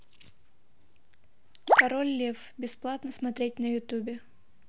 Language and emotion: Russian, neutral